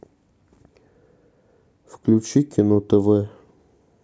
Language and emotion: Russian, neutral